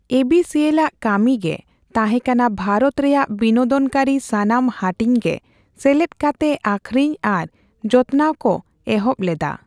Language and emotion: Santali, neutral